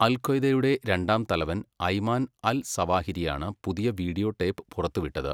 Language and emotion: Malayalam, neutral